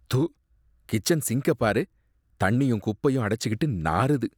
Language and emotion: Tamil, disgusted